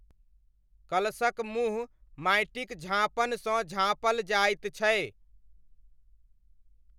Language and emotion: Maithili, neutral